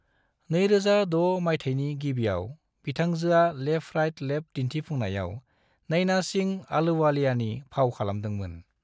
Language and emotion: Bodo, neutral